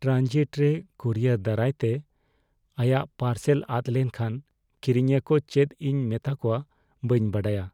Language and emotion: Santali, fearful